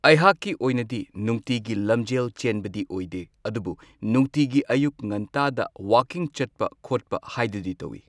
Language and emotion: Manipuri, neutral